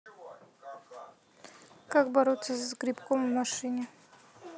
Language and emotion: Russian, neutral